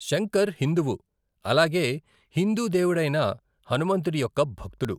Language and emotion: Telugu, neutral